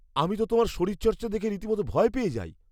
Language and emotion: Bengali, fearful